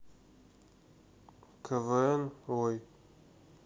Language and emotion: Russian, neutral